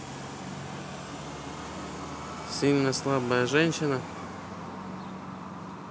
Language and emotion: Russian, neutral